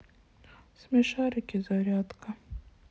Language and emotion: Russian, sad